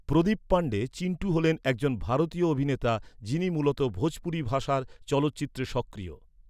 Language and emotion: Bengali, neutral